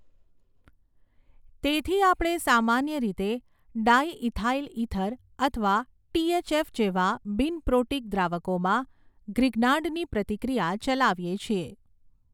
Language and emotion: Gujarati, neutral